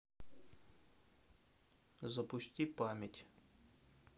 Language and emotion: Russian, neutral